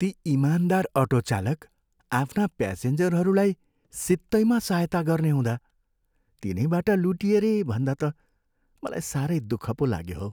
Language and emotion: Nepali, sad